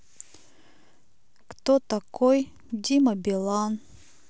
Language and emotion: Russian, neutral